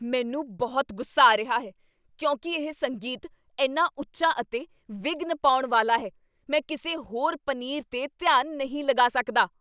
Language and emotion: Punjabi, angry